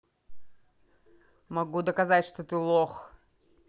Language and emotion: Russian, angry